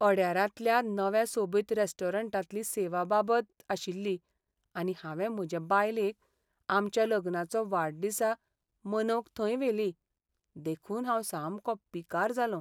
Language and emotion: Goan Konkani, sad